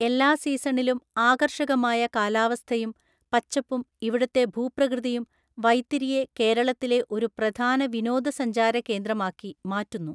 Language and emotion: Malayalam, neutral